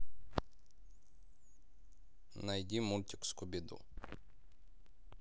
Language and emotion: Russian, neutral